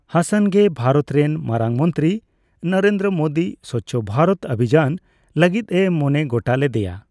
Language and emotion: Santali, neutral